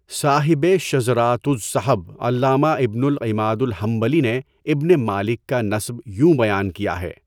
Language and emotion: Urdu, neutral